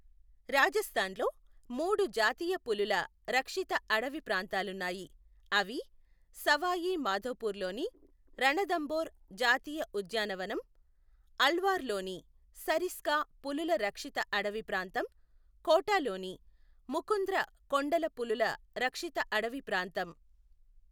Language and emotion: Telugu, neutral